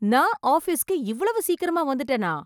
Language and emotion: Tamil, surprised